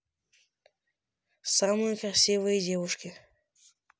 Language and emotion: Russian, neutral